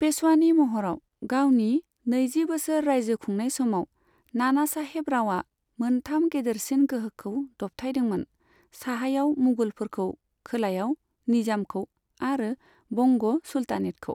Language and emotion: Bodo, neutral